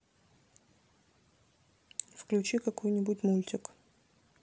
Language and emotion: Russian, neutral